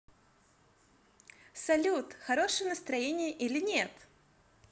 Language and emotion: Russian, positive